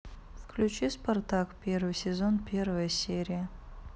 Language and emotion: Russian, neutral